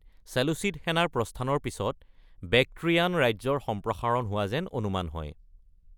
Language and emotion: Assamese, neutral